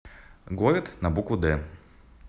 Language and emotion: Russian, neutral